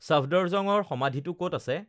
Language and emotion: Assamese, neutral